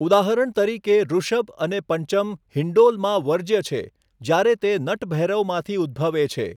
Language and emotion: Gujarati, neutral